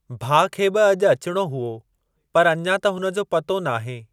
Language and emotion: Sindhi, neutral